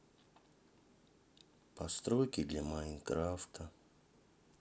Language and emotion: Russian, sad